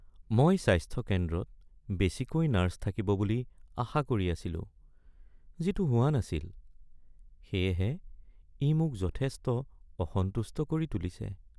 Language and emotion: Assamese, sad